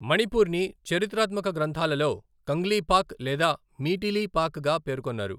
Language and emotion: Telugu, neutral